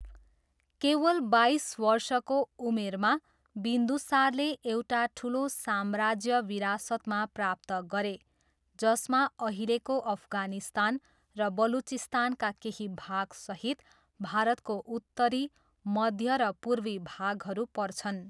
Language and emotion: Nepali, neutral